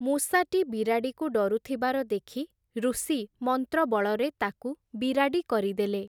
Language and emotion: Odia, neutral